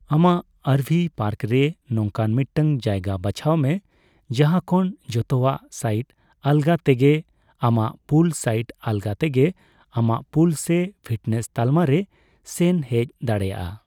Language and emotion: Santali, neutral